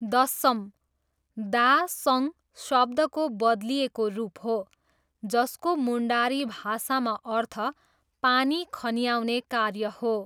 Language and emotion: Nepali, neutral